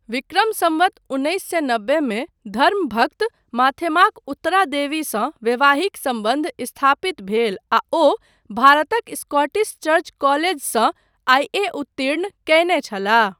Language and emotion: Maithili, neutral